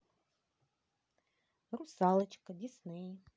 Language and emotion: Russian, positive